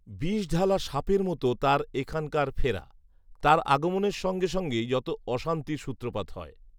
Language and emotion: Bengali, neutral